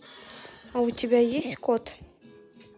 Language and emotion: Russian, neutral